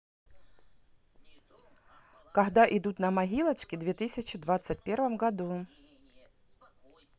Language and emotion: Russian, neutral